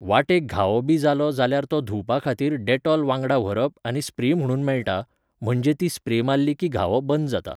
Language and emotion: Goan Konkani, neutral